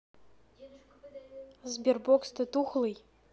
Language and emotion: Russian, neutral